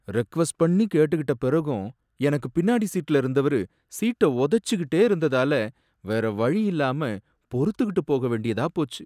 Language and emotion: Tamil, sad